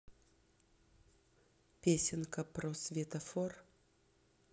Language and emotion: Russian, neutral